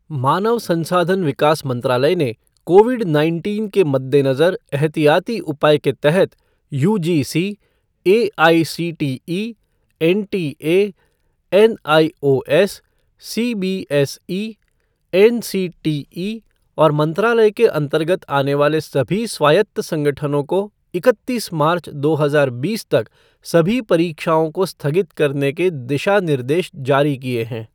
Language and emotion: Hindi, neutral